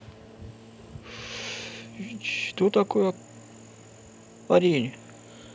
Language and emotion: Russian, neutral